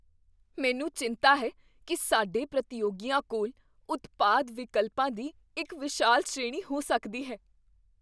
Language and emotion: Punjabi, fearful